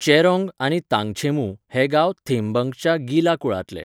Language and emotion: Goan Konkani, neutral